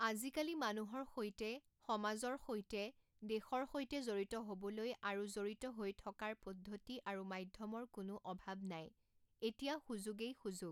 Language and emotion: Assamese, neutral